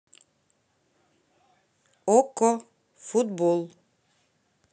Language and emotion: Russian, neutral